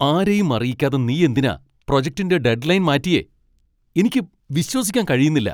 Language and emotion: Malayalam, angry